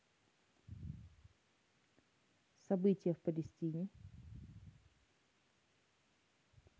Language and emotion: Russian, neutral